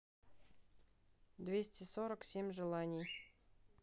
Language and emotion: Russian, neutral